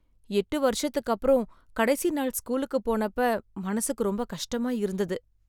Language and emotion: Tamil, sad